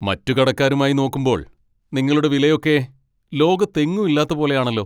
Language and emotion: Malayalam, angry